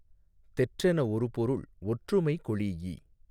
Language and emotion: Tamil, neutral